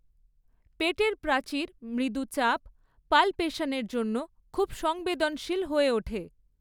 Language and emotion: Bengali, neutral